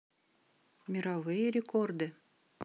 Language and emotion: Russian, neutral